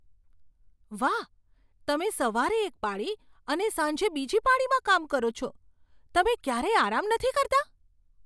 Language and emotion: Gujarati, surprised